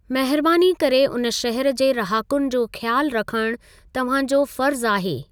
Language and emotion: Sindhi, neutral